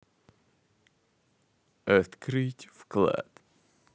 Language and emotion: Russian, positive